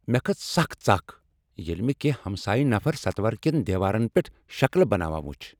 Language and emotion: Kashmiri, angry